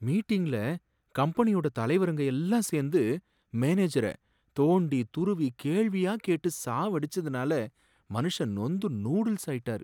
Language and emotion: Tamil, sad